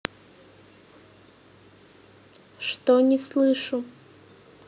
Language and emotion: Russian, neutral